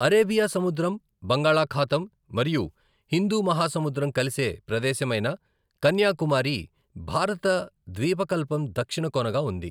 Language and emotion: Telugu, neutral